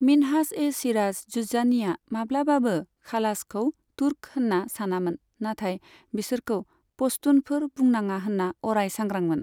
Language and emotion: Bodo, neutral